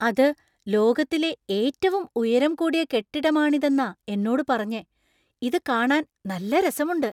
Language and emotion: Malayalam, surprised